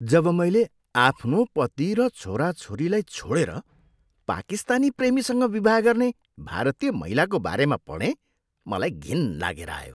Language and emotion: Nepali, disgusted